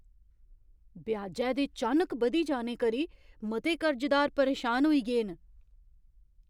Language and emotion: Dogri, surprised